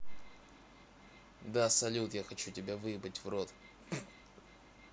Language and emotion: Russian, neutral